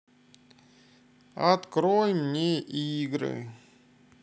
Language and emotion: Russian, sad